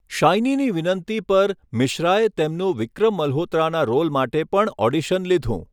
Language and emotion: Gujarati, neutral